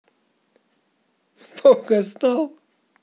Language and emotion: Russian, positive